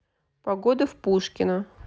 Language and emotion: Russian, neutral